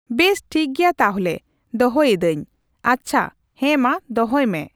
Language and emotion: Santali, neutral